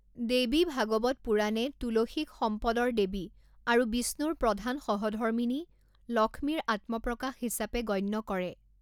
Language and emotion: Assamese, neutral